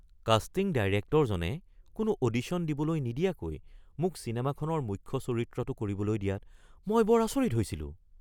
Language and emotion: Assamese, surprised